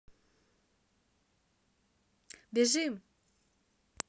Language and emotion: Russian, neutral